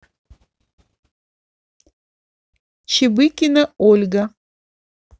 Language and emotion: Russian, neutral